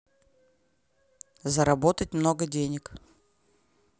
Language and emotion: Russian, neutral